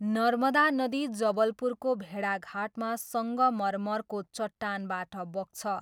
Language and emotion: Nepali, neutral